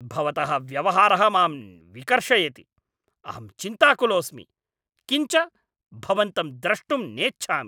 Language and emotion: Sanskrit, angry